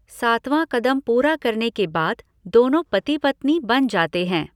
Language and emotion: Hindi, neutral